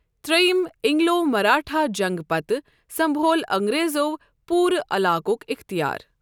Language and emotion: Kashmiri, neutral